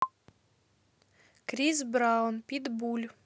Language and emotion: Russian, neutral